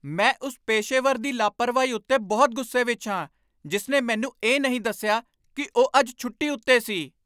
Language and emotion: Punjabi, angry